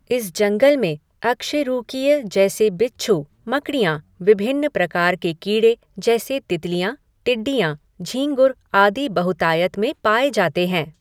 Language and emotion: Hindi, neutral